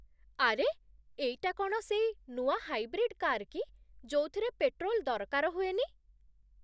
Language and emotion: Odia, surprised